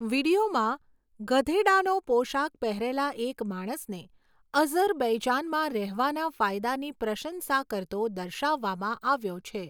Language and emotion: Gujarati, neutral